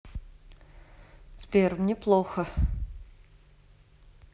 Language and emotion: Russian, sad